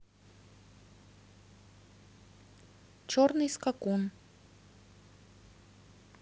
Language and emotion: Russian, neutral